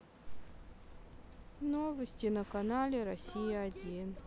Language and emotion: Russian, sad